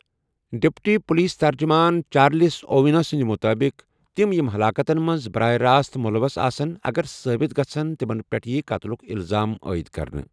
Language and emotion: Kashmiri, neutral